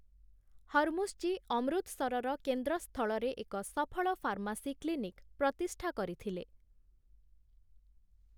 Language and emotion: Odia, neutral